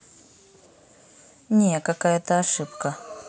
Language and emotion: Russian, neutral